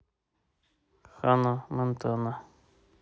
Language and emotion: Russian, neutral